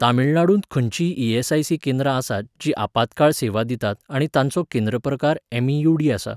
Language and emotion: Goan Konkani, neutral